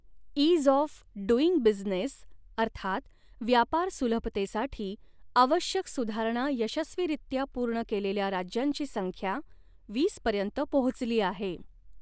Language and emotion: Marathi, neutral